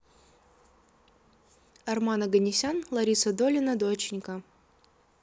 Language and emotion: Russian, neutral